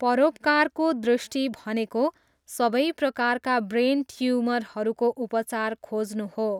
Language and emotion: Nepali, neutral